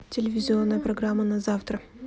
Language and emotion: Russian, neutral